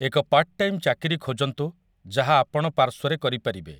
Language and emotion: Odia, neutral